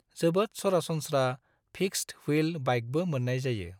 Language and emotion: Bodo, neutral